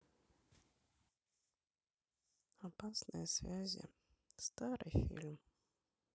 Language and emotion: Russian, sad